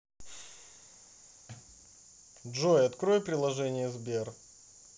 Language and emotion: Russian, neutral